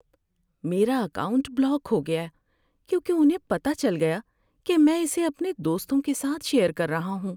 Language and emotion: Urdu, sad